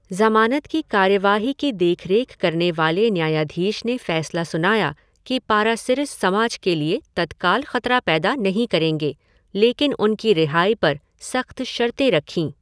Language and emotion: Hindi, neutral